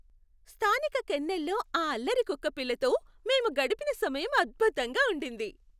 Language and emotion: Telugu, happy